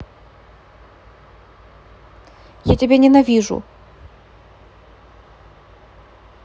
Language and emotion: Russian, sad